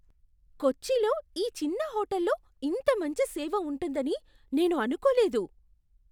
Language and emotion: Telugu, surprised